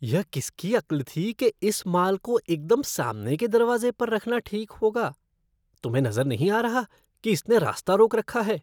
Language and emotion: Hindi, disgusted